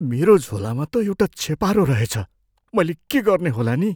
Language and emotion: Nepali, fearful